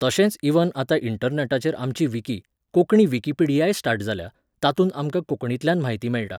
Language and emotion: Goan Konkani, neutral